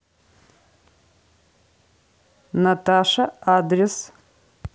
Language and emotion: Russian, neutral